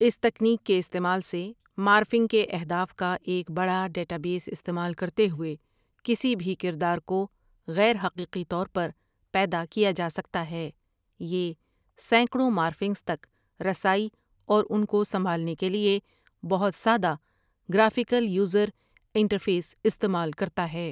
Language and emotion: Urdu, neutral